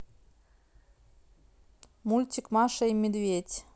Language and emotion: Russian, neutral